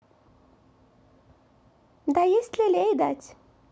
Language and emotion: Russian, neutral